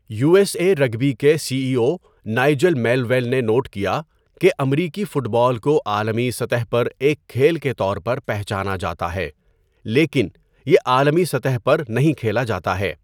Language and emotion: Urdu, neutral